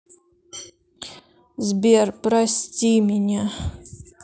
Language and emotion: Russian, sad